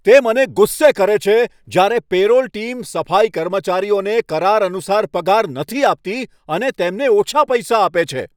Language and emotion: Gujarati, angry